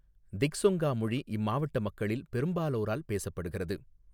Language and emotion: Tamil, neutral